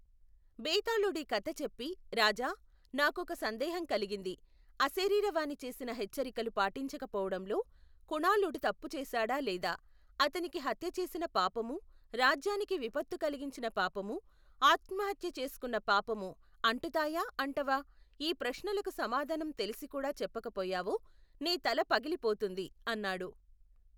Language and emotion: Telugu, neutral